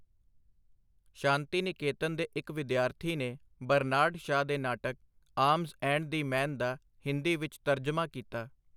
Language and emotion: Punjabi, neutral